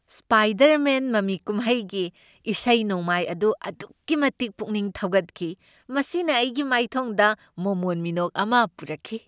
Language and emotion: Manipuri, happy